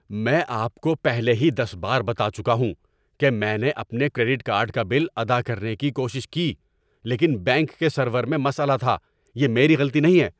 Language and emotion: Urdu, angry